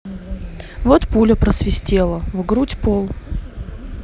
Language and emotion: Russian, neutral